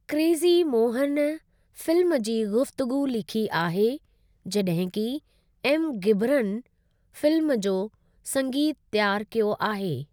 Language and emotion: Sindhi, neutral